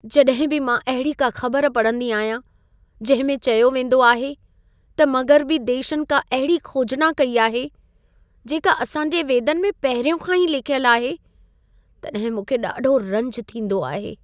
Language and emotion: Sindhi, sad